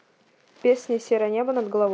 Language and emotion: Russian, neutral